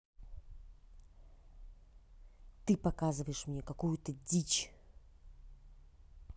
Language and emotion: Russian, angry